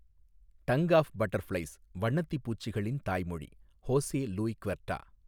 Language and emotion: Tamil, neutral